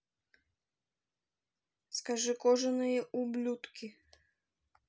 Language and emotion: Russian, neutral